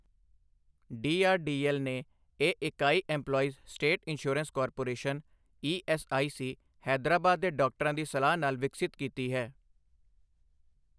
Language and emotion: Punjabi, neutral